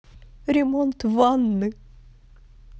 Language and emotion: Russian, sad